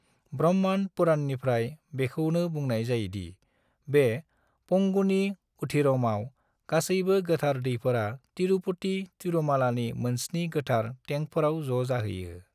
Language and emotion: Bodo, neutral